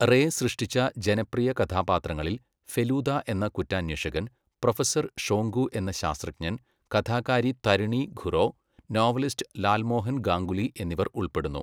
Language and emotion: Malayalam, neutral